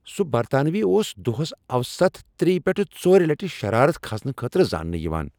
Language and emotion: Kashmiri, angry